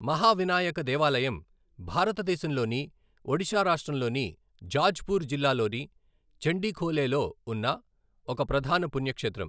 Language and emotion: Telugu, neutral